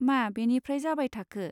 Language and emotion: Bodo, neutral